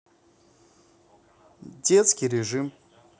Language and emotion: Russian, neutral